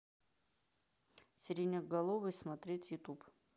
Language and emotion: Russian, neutral